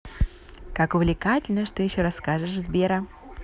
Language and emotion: Russian, positive